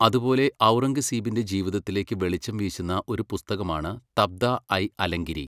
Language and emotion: Malayalam, neutral